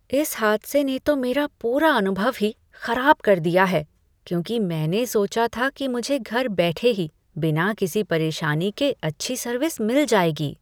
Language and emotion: Hindi, disgusted